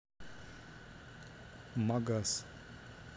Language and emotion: Russian, neutral